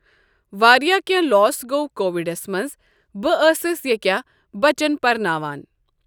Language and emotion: Kashmiri, neutral